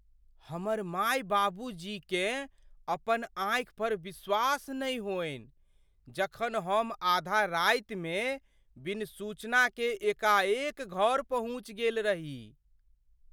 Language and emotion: Maithili, surprised